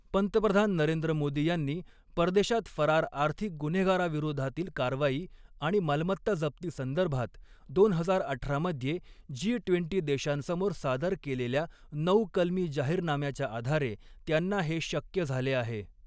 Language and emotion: Marathi, neutral